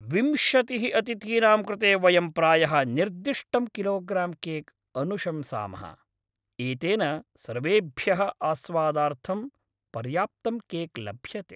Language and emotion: Sanskrit, happy